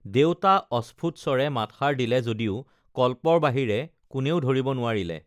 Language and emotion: Assamese, neutral